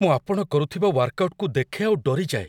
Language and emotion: Odia, fearful